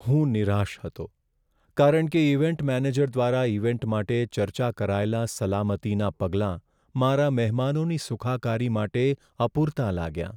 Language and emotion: Gujarati, sad